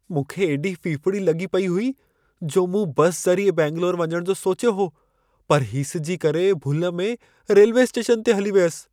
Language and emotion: Sindhi, fearful